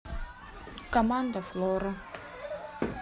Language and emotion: Russian, neutral